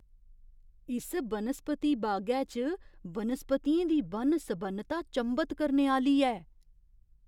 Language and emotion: Dogri, surprised